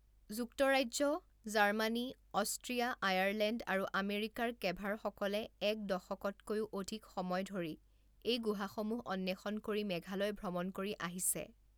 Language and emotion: Assamese, neutral